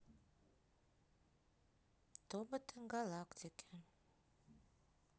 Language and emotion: Russian, neutral